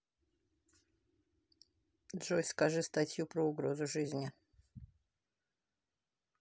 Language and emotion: Russian, neutral